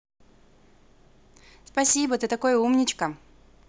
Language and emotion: Russian, positive